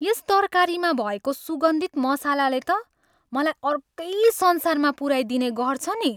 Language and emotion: Nepali, happy